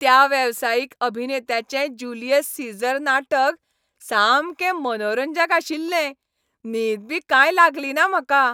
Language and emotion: Goan Konkani, happy